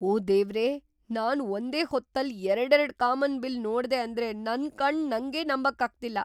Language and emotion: Kannada, surprised